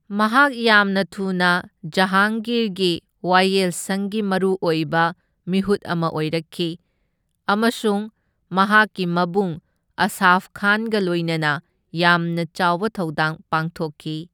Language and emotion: Manipuri, neutral